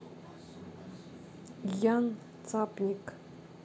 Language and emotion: Russian, neutral